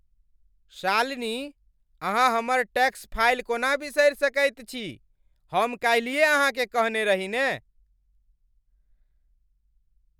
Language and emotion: Maithili, angry